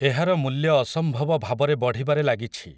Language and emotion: Odia, neutral